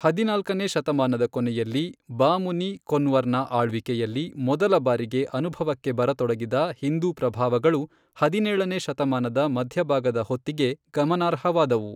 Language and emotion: Kannada, neutral